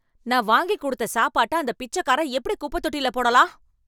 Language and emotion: Tamil, angry